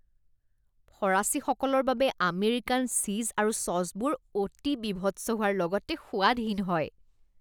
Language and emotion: Assamese, disgusted